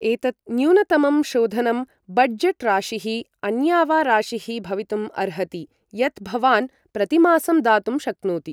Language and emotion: Sanskrit, neutral